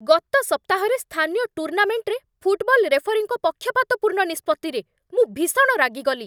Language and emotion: Odia, angry